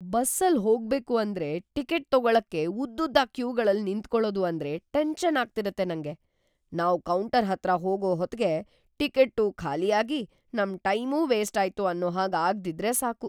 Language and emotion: Kannada, fearful